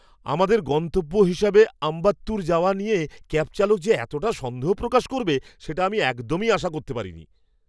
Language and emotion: Bengali, surprised